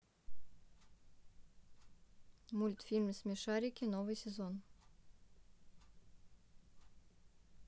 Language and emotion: Russian, neutral